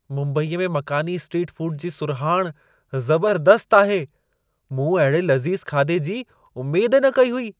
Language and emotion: Sindhi, surprised